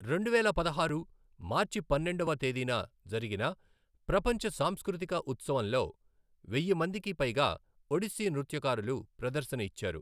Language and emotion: Telugu, neutral